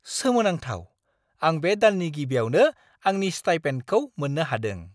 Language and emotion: Bodo, surprised